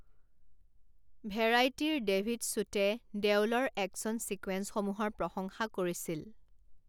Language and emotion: Assamese, neutral